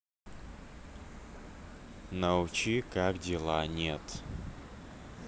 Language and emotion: Russian, neutral